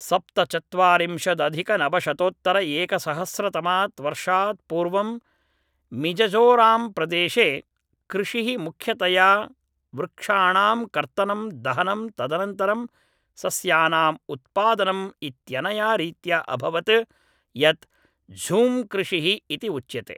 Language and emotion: Sanskrit, neutral